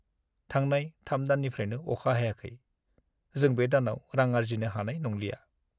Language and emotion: Bodo, sad